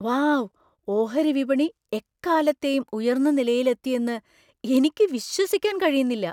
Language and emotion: Malayalam, surprised